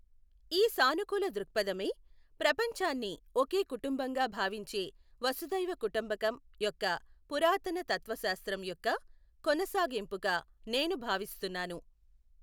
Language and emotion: Telugu, neutral